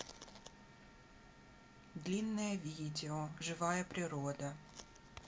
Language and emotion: Russian, neutral